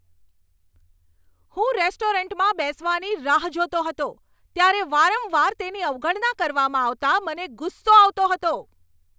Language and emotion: Gujarati, angry